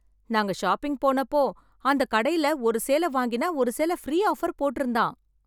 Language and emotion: Tamil, happy